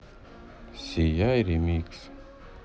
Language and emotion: Russian, neutral